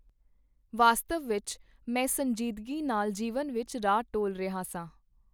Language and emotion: Punjabi, neutral